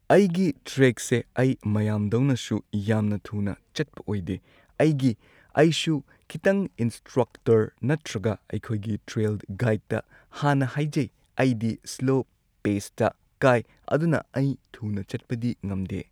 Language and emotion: Manipuri, neutral